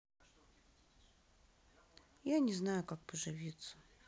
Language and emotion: Russian, sad